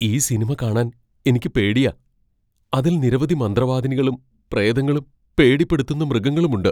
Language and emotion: Malayalam, fearful